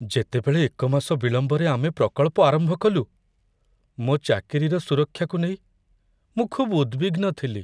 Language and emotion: Odia, fearful